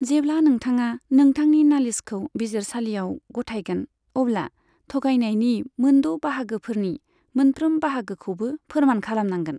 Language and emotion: Bodo, neutral